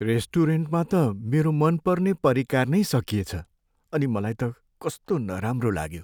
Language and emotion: Nepali, sad